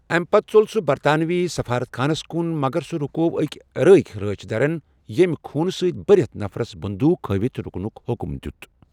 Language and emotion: Kashmiri, neutral